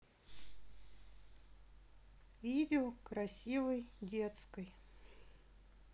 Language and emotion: Russian, neutral